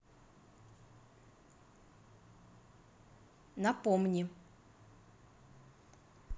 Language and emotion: Russian, neutral